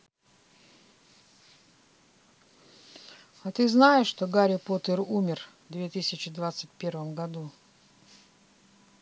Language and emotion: Russian, neutral